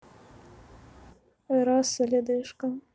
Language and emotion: Russian, sad